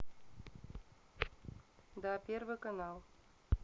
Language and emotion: Russian, neutral